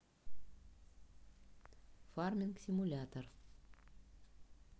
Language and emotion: Russian, neutral